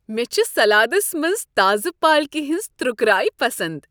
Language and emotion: Kashmiri, happy